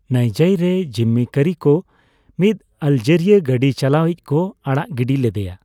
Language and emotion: Santali, neutral